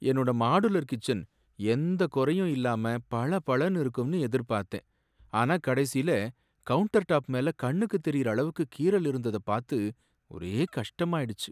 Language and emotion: Tamil, sad